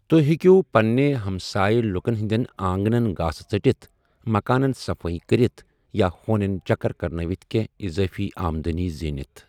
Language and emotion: Kashmiri, neutral